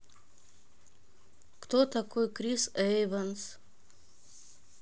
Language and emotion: Russian, neutral